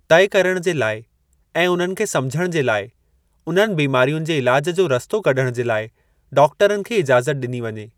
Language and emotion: Sindhi, neutral